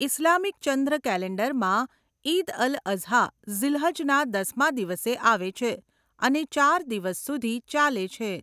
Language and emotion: Gujarati, neutral